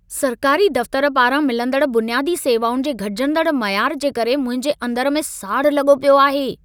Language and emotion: Sindhi, angry